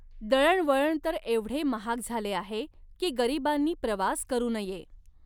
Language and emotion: Marathi, neutral